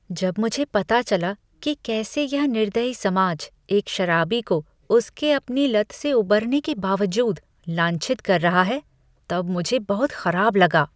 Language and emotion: Hindi, disgusted